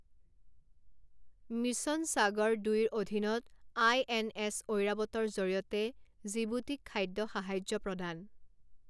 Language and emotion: Assamese, neutral